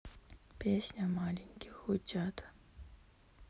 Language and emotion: Russian, sad